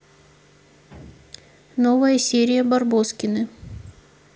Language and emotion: Russian, neutral